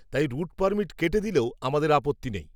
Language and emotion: Bengali, neutral